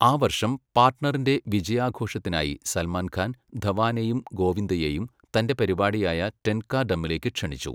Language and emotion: Malayalam, neutral